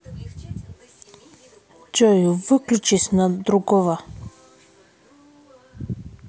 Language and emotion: Russian, angry